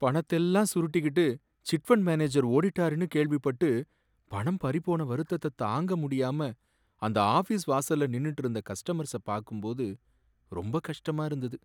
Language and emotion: Tamil, sad